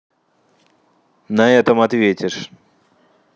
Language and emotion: Russian, angry